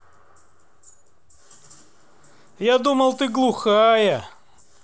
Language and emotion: Russian, neutral